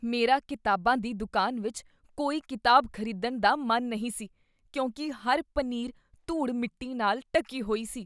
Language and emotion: Punjabi, disgusted